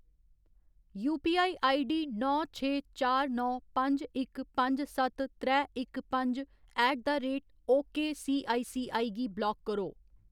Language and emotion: Dogri, neutral